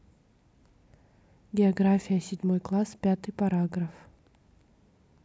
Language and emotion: Russian, neutral